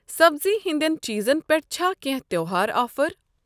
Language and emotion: Kashmiri, neutral